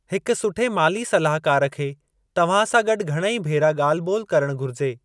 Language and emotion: Sindhi, neutral